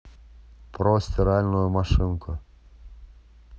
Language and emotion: Russian, neutral